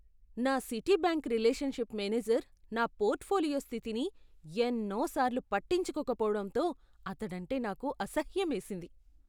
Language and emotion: Telugu, disgusted